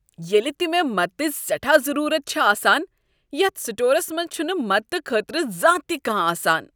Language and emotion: Kashmiri, disgusted